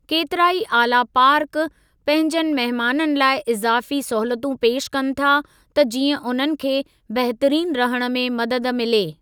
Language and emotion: Sindhi, neutral